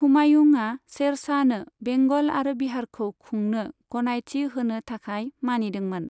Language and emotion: Bodo, neutral